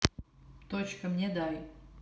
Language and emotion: Russian, neutral